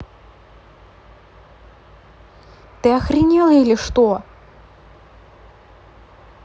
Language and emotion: Russian, angry